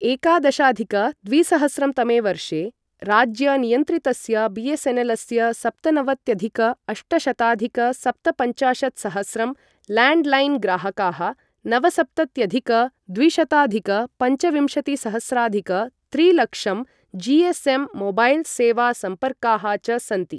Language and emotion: Sanskrit, neutral